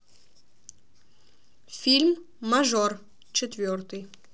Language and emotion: Russian, neutral